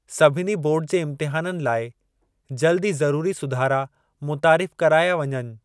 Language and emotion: Sindhi, neutral